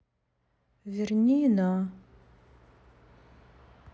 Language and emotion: Russian, sad